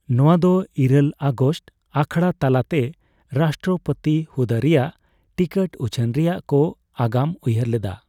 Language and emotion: Santali, neutral